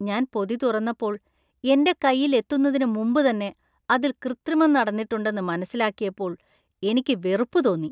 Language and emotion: Malayalam, disgusted